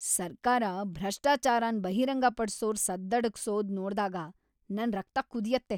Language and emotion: Kannada, angry